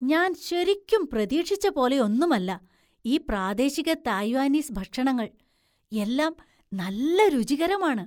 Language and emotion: Malayalam, surprised